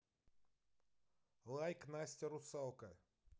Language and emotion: Russian, neutral